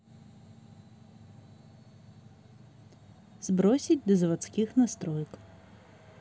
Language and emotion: Russian, neutral